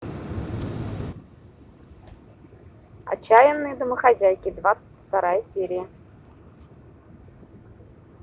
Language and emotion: Russian, positive